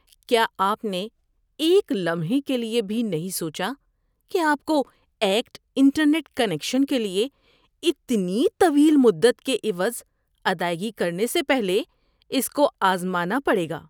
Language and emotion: Urdu, disgusted